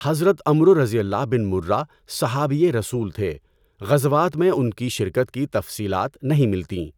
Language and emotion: Urdu, neutral